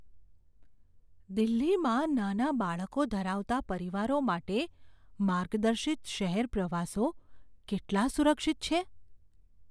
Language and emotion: Gujarati, fearful